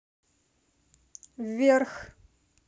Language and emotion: Russian, neutral